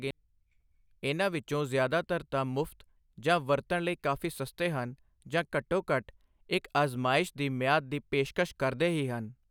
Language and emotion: Punjabi, neutral